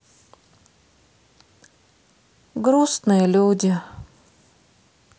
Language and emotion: Russian, sad